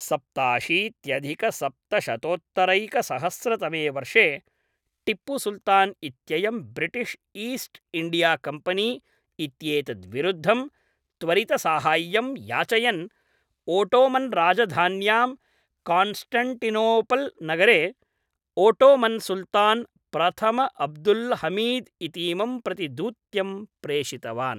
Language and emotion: Sanskrit, neutral